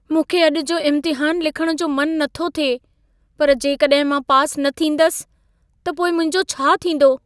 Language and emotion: Sindhi, fearful